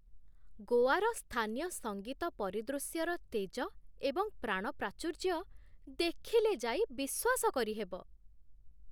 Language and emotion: Odia, surprised